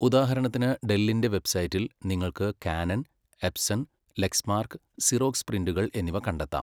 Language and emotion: Malayalam, neutral